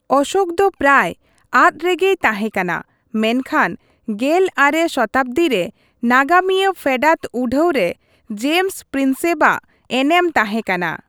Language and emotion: Santali, neutral